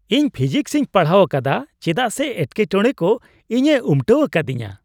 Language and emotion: Santali, happy